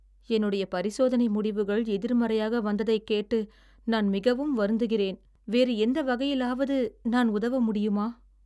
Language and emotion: Tamil, sad